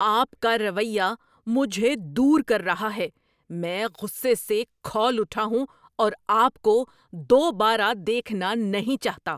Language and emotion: Urdu, angry